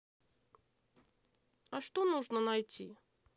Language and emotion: Russian, neutral